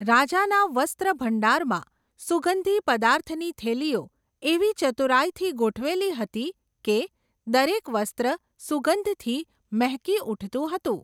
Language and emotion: Gujarati, neutral